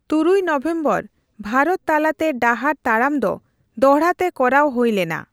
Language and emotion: Santali, neutral